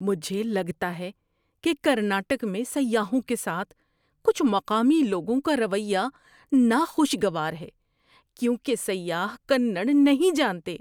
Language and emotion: Urdu, disgusted